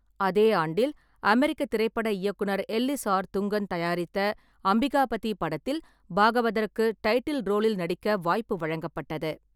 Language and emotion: Tamil, neutral